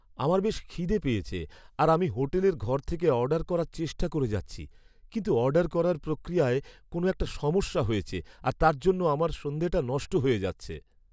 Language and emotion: Bengali, sad